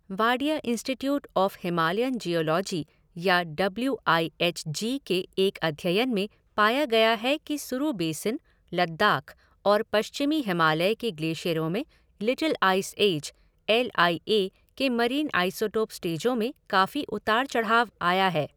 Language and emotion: Hindi, neutral